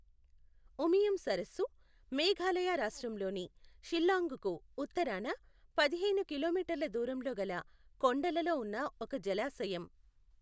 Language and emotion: Telugu, neutral